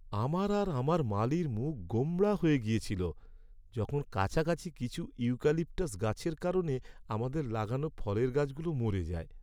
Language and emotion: Bengali, sad